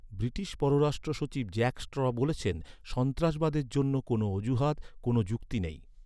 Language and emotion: Bengali, neutral